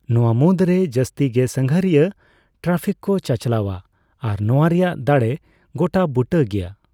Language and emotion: Santali, neutral